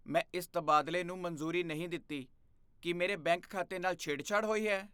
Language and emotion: Punjabi, fearful